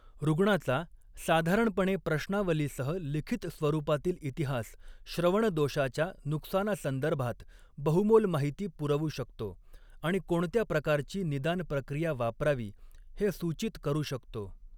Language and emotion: Marathi, neutral